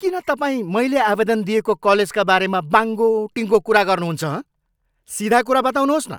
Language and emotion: Nepali, angry